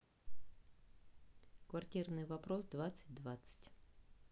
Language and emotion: Russian, neutral